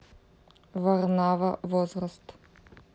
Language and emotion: Russian, neutral